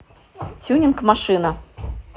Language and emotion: Russian, neutral